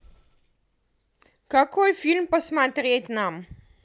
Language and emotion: Russian, neutral